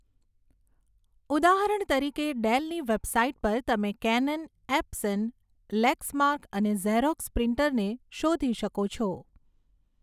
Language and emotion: Gujarati, neutral